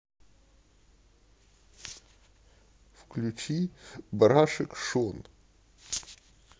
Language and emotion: Russian, sad